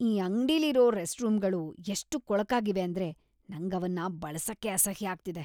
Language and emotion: Kannada, disgusted